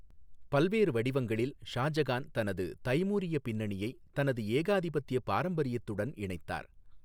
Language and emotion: Tamil, neutral